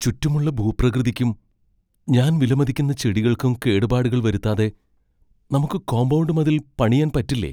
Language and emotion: Malayalam, fearful